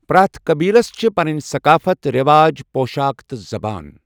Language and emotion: Kashmiri, neutral